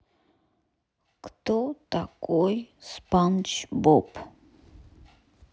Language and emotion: Russian, neutral